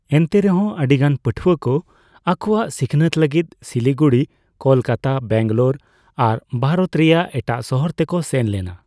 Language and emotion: Santali, neutral